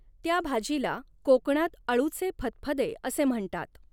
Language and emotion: Marathi, neutral